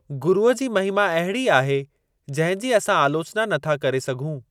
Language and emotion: Sindhi, neutral